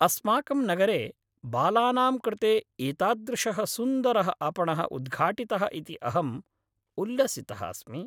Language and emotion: Sanskrit, happy